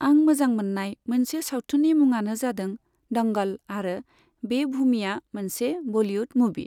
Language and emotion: Bodo, neutral